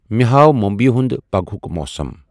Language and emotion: Kashmiri, neutral